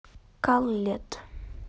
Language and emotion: Russian, neutral